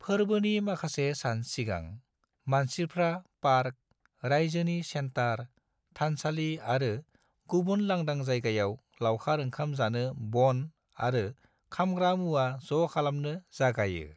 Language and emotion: Bodo, neutral